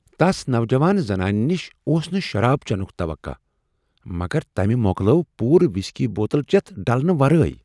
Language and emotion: Kashmiri, surprised